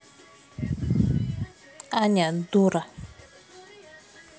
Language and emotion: Russian, neutral